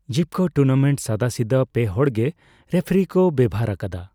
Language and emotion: Santali, neutral